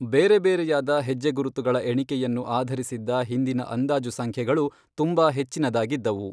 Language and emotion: Kannada, neutral